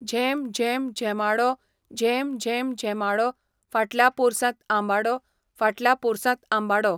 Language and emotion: Goan Konkani, neutral